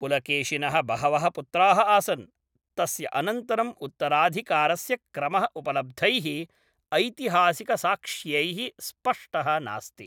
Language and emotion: Sanskrit, neutral